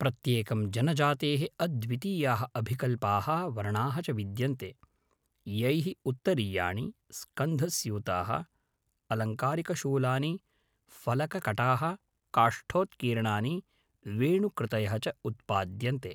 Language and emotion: Sanskrit, neutral